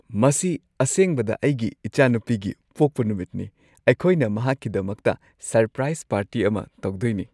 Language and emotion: Manipuri, happy